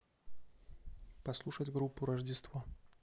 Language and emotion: Russian, neutral